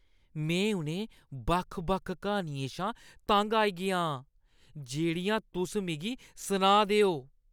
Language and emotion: Dogri, disgusted